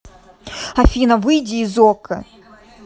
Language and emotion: Russian, angry